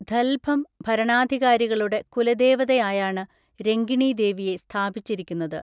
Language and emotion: Malayalam, neutral